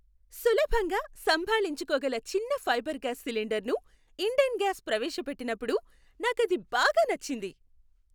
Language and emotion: Telugu, happy